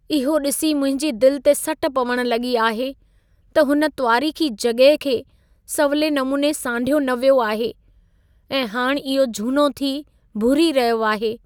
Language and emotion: Sindhi, sad